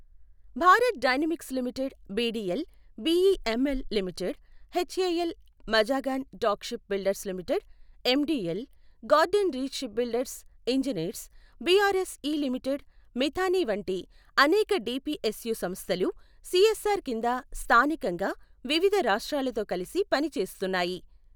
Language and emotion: Telugu, neutral